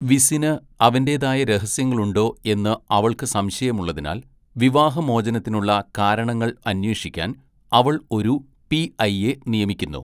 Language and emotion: Malayalam, neutral